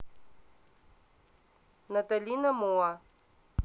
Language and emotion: Russian, neutral